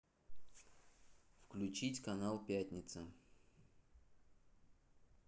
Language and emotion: Russian, neutral